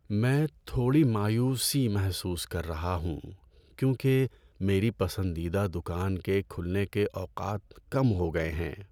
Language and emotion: Urdu, sad